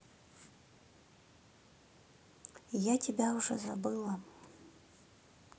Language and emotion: Russian, neutral